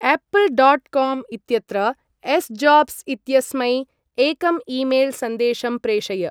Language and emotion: Sanskrit, neutral